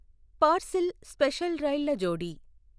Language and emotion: Telugu, neutral